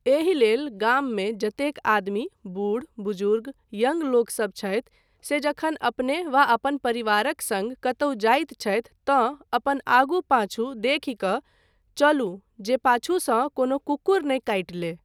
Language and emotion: Maithili, neutral